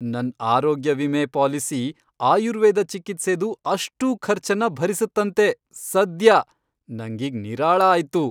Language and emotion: Kannada, happy